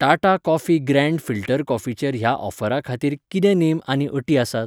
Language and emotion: Goan Konkani, neutral